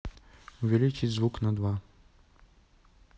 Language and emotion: Russian, neutral